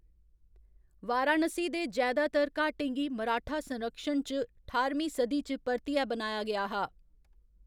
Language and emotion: Dogri, neutral